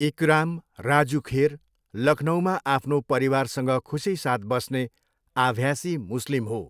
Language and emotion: Nepali, neutral